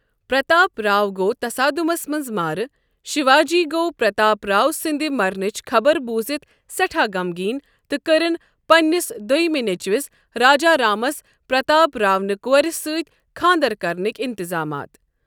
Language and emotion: Kashmiri, neutral